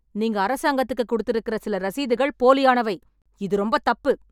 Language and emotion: Tamil, angry